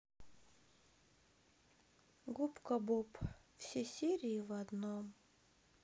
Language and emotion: Russian, sad